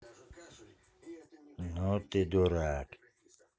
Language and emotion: Russian, angry